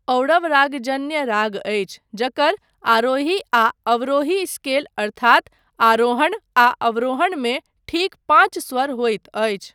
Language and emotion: Maithili, neutral